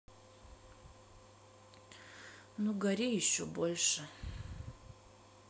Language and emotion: Russian, sad